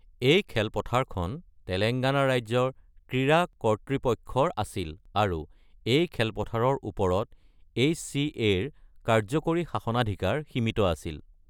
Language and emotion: Assamese, neutral